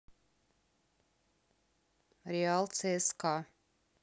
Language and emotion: Russian, neutral